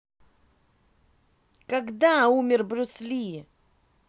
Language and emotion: Russian, angry